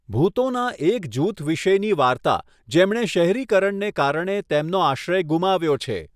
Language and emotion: Gujarati, neutral